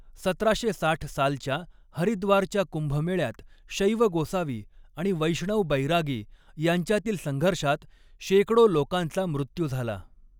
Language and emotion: Marathi, neutral